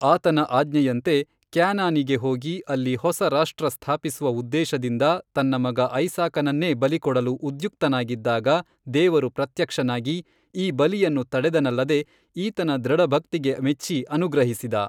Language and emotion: Kannada, neutral